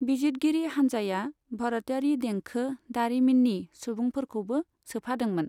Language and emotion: Bodo, neutral